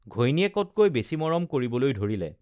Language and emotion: Assamese, neutral